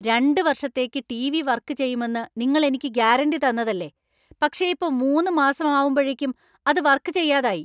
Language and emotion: Malayalam, angry